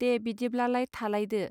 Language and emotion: Bodo, neutral